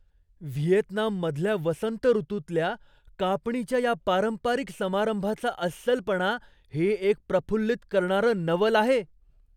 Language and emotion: Marathi, surprised